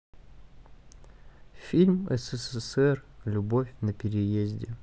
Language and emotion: Russian, neutral